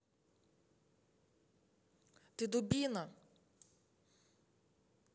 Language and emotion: Russian, angry